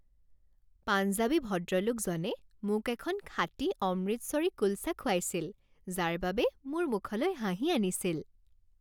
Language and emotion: Assamese, happy